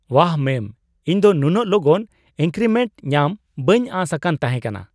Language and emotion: Santali, surprised